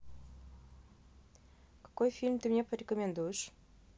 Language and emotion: Russian, neutral